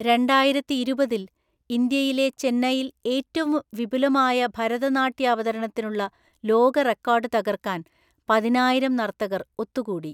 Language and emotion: Malayalam, neutral